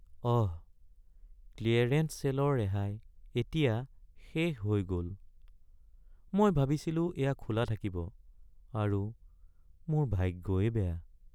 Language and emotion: Assamese, sad